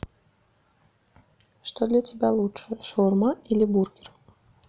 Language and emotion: Russian, neutral